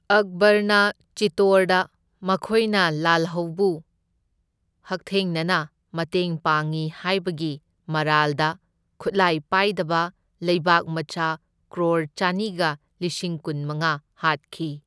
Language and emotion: Manipuri, neutral